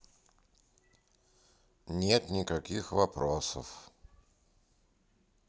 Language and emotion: Russian, neutral